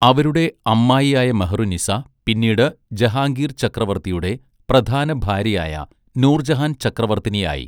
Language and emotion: Malayalam, neutral